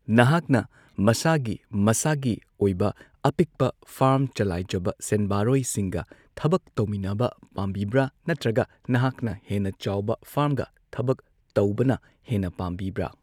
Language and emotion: Manipuri, neutral